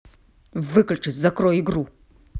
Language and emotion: Russian, angry